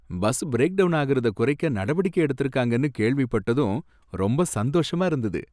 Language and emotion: Tamil, happy